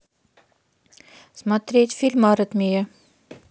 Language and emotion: Russian, neutral